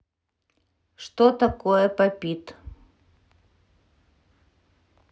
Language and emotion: Russian, neutral